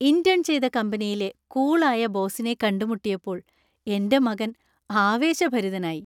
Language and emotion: Malayalam, happy